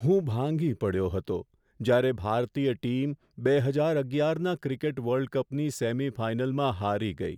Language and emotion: Gujarati, sad